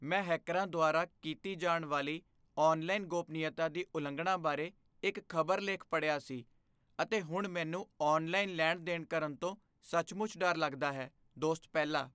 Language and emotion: Punjabi, fearful